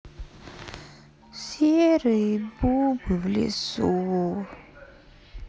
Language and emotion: Russian, sad